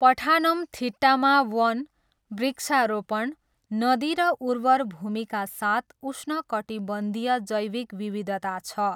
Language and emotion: Nepali, neutral